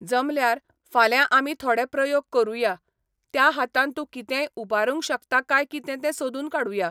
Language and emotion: Goan Konkani, neutral